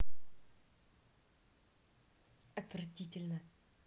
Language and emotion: Russian, neutral